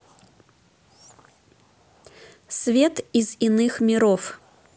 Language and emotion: Russian, neutral